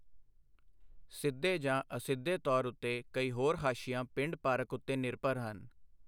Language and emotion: Punjabi, neutral